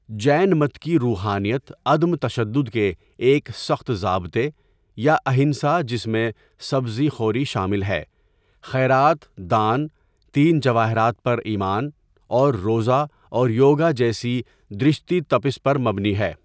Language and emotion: Urdu, neutral